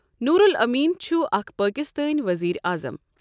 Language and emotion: Kashmiri, neutral